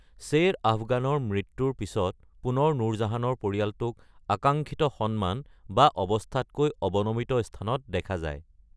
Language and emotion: Assamese, neutral